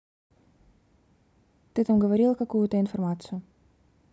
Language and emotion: Russian, neutral